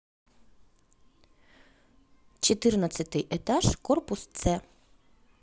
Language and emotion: Russian, neutral